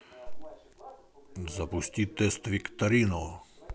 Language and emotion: Russian, positive